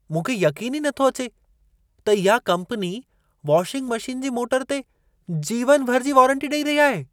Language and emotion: Sindhi, surprised